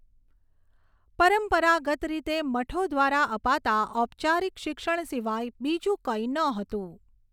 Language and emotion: Gujarati, neutral